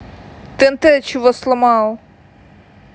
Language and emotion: Russian, neutral